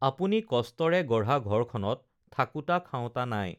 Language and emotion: Assamese, neutral